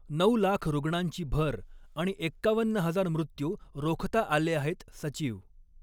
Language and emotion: Marathi, neutral